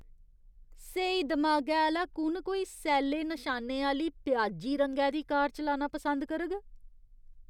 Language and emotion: Dogri, disgusted